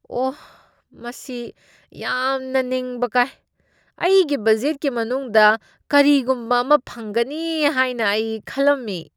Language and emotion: Manipuri, disgusted